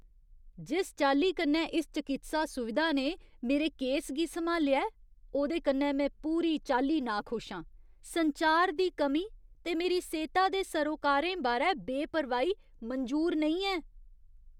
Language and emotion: Dogri, disgusted